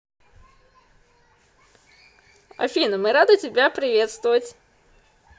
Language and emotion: Russian, positive